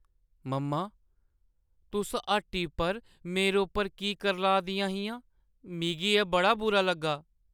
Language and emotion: Dogri, sad